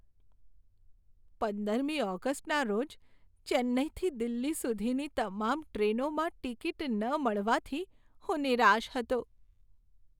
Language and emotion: Gujarati, sad